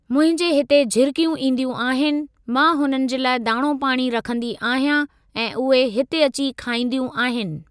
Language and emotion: Sindhi, neutral